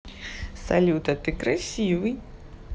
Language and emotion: Russian, positive